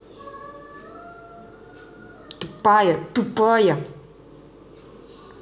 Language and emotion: Russian, angry